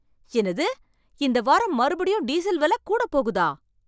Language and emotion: Tamil, surprised